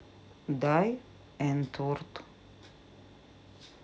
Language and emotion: Russian, neutral